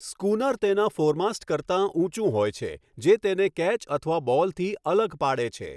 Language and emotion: Gujarati, neutral